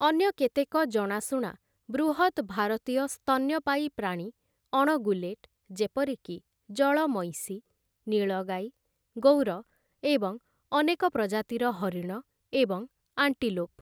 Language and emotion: Odia, neutral